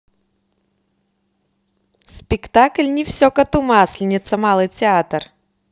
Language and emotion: Russian, positive